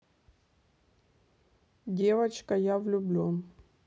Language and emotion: Russian, neutral